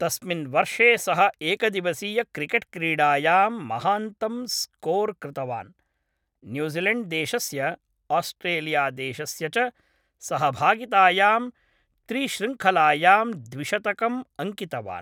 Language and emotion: Sanskrit, neutral